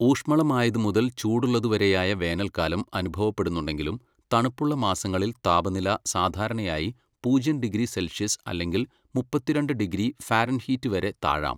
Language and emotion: Malayalam, neutral